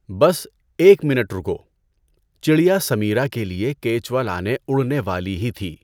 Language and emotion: Urdu, neutral